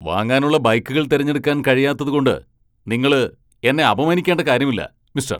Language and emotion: Malayalam, angry